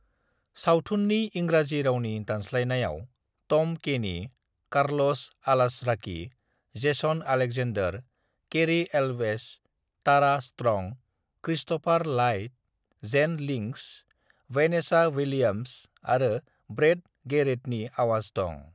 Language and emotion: Bodo, neutral